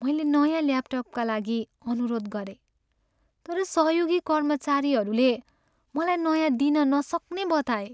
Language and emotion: Nepali, sad